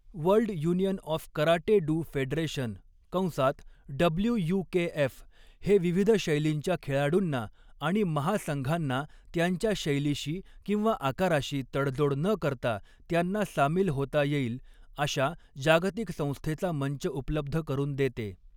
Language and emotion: Marathi, neutral